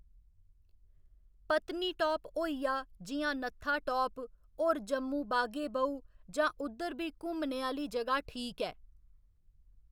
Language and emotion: Dogri, neutral